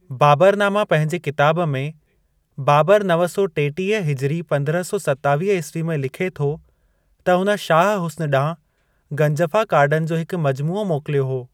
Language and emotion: Sindhi, neutral